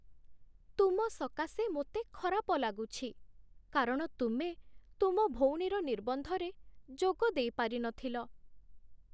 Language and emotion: Odia, sad